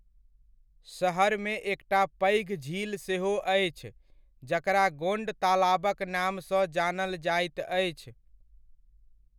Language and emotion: Maithili, neutral